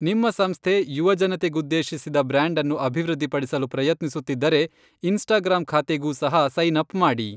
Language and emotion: Kannada, neutral